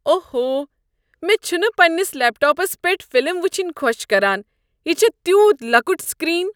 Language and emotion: Kashmiri, disgusted